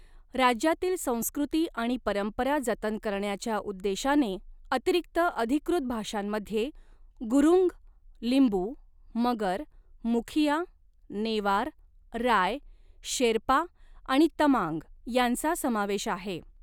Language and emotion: Marathi, neutral